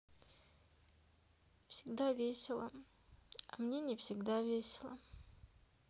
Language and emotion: Russian, sad